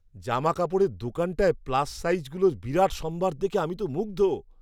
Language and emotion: Bengali, surprised